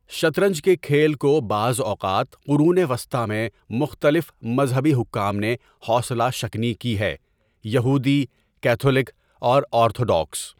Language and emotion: Urdu, neutral